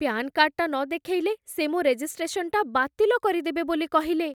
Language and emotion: Odia, fearful